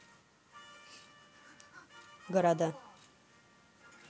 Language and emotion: Russian, neutral